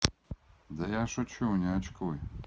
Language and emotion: Russian, neutral